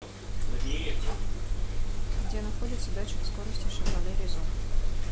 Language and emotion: Russian, neutral